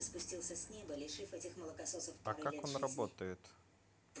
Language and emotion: Russian, neutral